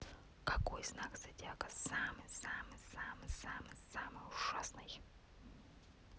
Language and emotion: Russian, neutral